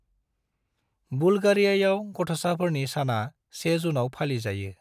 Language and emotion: Bodo, neutral